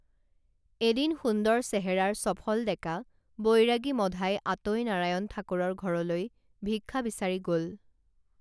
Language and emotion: Assamese, neutral